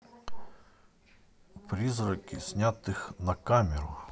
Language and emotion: Russian, neutral